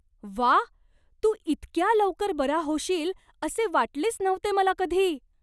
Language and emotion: Marathi, surprised